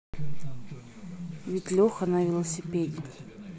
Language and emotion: Russian, neutral